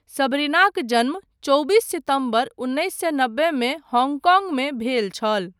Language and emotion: Maithili, neutral